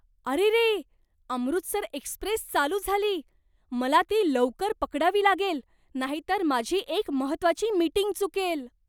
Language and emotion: Marathi, surprised